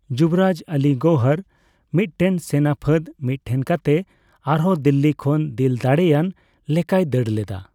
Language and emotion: Santali, neutral